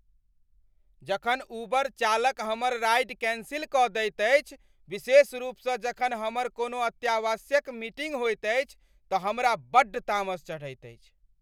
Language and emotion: Maithili, angry